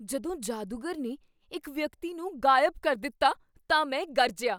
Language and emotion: Punjabi, surprised